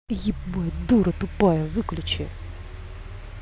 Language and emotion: Russian, angry